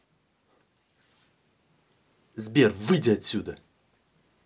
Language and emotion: Russian, angry